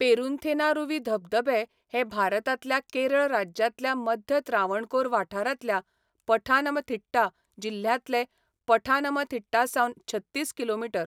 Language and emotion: Goan Konkani, neutral